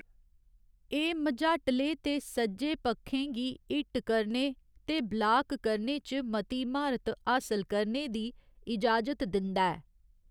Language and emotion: Dogri, neutral